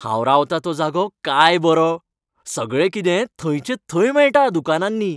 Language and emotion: Goan Konkani, happy